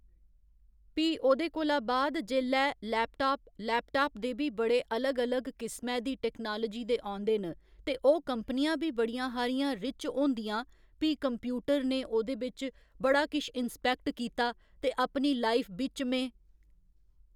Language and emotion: Dogri, neutral